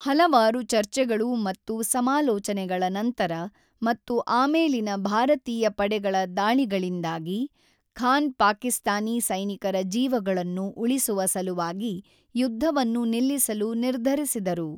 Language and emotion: Kannada, neutral